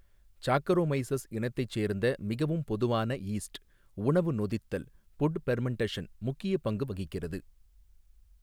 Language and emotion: Tamil, neutral